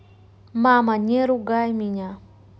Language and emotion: Russian, neutral